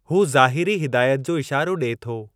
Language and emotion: Sindhi, neutral